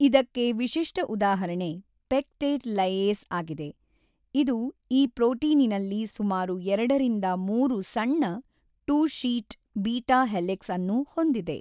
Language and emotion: Kannada, neutral